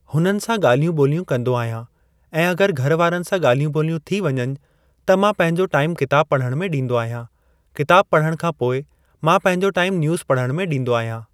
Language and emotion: Sindhi, neutral